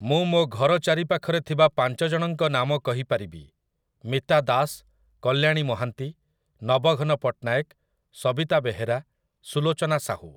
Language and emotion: Odia, neutral